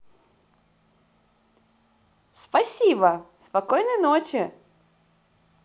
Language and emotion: Russian, positive